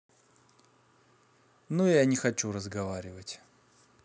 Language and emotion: Russian, neutral